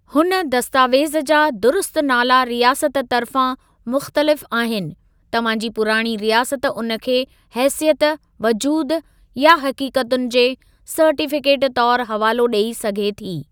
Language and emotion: Sindhi, neutral